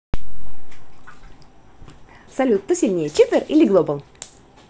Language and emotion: Russian, positive